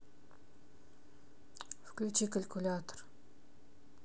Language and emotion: Russian, neutral